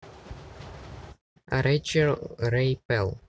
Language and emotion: Russian, neutral